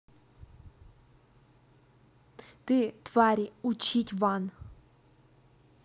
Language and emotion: Russian, angry